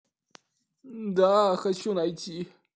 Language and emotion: Russian, sad